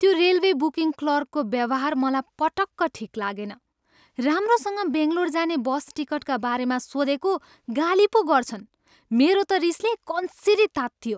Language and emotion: Nepali, angry